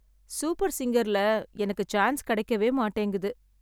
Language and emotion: Tamil, sad